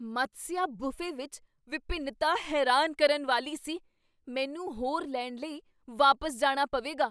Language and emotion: Punjabi, surprised